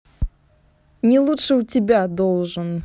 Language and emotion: Russian, neutral